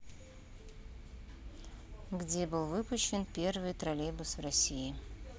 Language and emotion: Russian, neutral